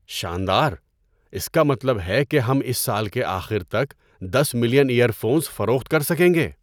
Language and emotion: Urdu, surprised